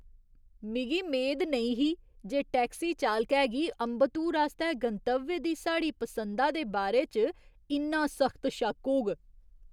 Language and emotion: Dogri, surprised